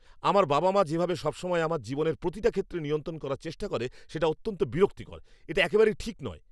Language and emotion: Bengali, angry